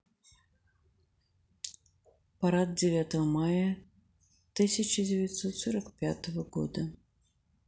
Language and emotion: Russian, sad